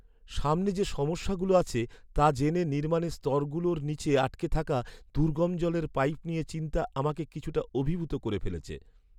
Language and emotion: Bengali, sad